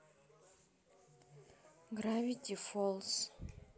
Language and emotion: Russian, neutral